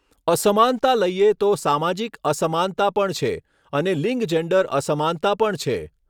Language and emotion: Gujarati, neutral